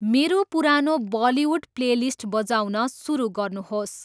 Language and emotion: Nepali, neutral